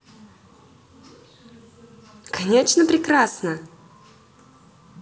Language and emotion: Russian, positive